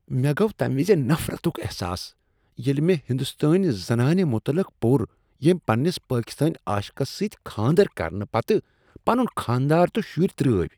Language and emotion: Kashmiri, disgusted